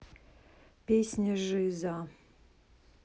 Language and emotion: Russian, neutral